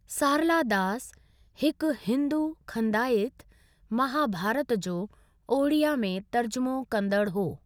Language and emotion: Sindhi, neutral